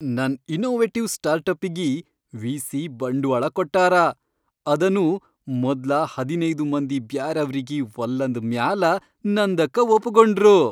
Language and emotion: Kannada, happy